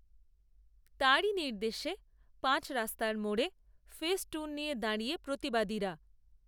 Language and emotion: Bengali, neutral